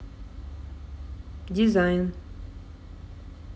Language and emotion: Russian, neutral